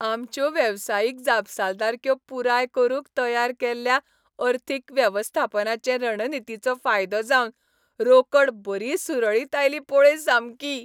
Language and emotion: Goan Konkani, happy